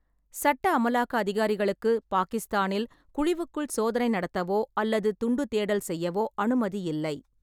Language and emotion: Tamil, neutral